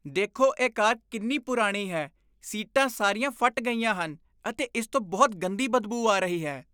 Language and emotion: Punjabi, disgusted